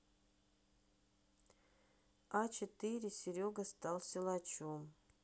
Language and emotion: Russian, neutral